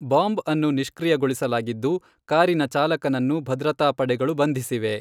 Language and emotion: Kannada, neutral